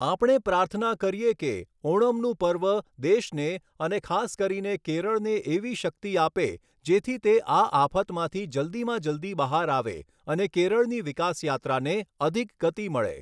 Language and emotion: Gujarati, neutral